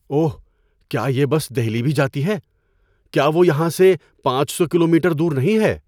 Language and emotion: Urdu, surprised